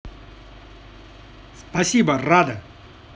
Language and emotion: Russian, positive